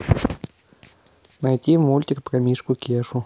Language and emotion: Russian, neutral